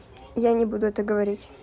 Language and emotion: Russian, neutral